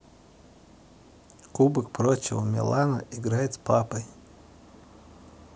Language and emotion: Russian, neutral